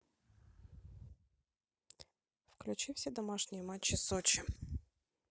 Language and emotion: Russian, neutral